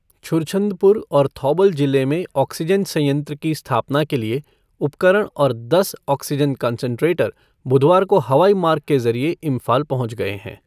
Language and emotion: Hindi, neutral